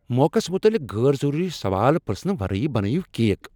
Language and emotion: Kashmiri, angry